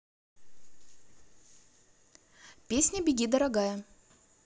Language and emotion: Russian, neutral